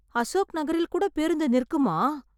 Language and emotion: Tamil, surprised